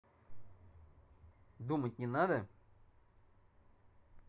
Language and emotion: Russian, angry